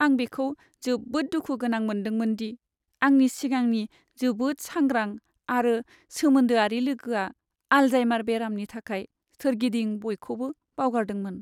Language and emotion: Bodo, sad